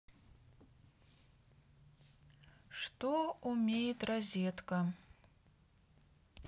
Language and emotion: Russian, neutral